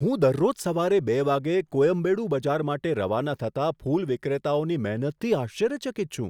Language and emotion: Gujarati, surprised